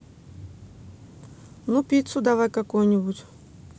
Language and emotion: Russian, neutral